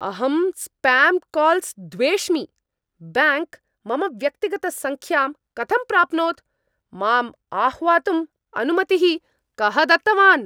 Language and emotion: Sanskrit, angry